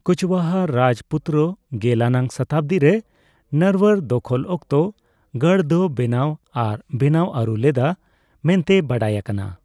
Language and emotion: Santali, neutral